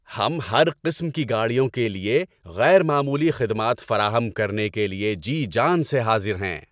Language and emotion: Urdu, happy